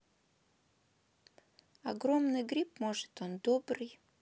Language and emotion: Russian, neutral